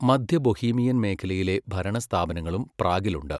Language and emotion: Malayalam, neutral